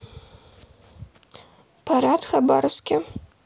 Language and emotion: Russian, neutral